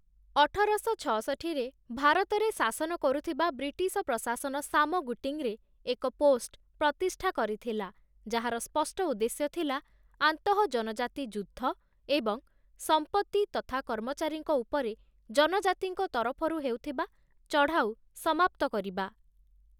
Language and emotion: Odia, neutral